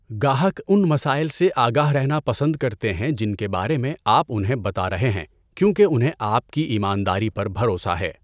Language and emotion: Urdu, neutral